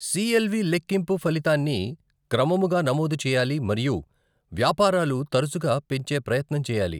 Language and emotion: Telugu, neutral